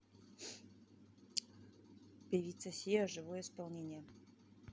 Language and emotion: Russian, neutral